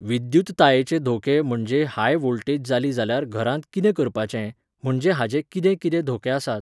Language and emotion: Goan Konkani, neutral